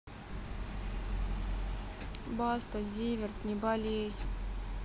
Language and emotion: Russian, sad